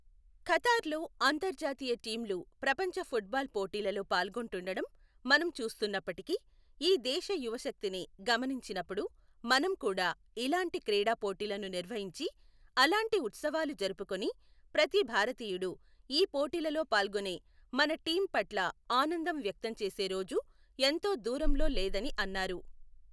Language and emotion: Telugu, neutral